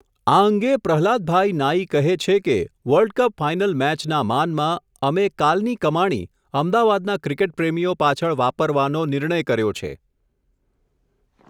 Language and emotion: Gujarati, neutral